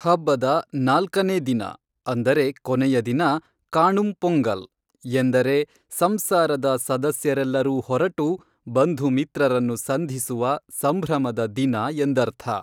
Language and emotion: Kannada, neutral